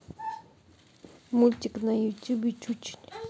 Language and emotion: Russian, neutral